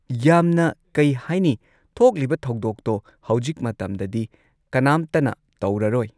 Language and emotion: Manipuri, neutral